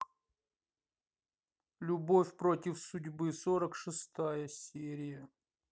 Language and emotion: Russian, neutral